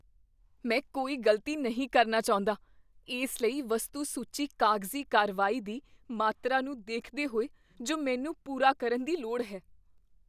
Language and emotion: Punjabi, fearful